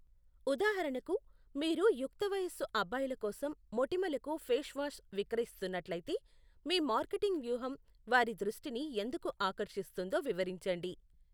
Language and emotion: Telugu, neutral